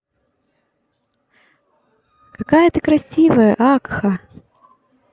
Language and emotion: Russian, positive